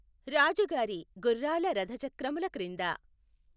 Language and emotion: Telugu, neutral